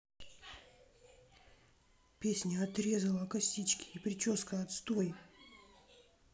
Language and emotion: Russian, sad